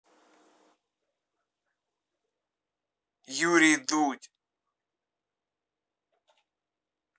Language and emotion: Russian, neutral